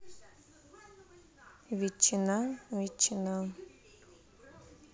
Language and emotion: Russian, neutral